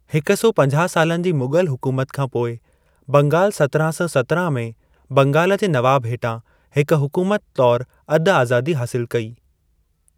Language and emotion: Sindhi, neutral